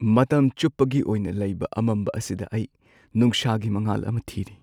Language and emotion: Manipuri, sad